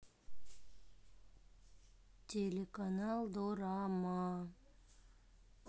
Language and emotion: Russian, sad